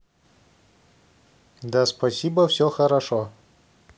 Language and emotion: Russian, neutral